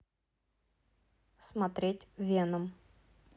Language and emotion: Russian, neutral